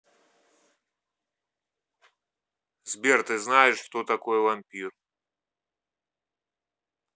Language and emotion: Russian, neutral